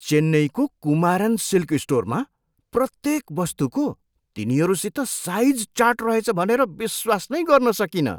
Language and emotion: Nepali, surprised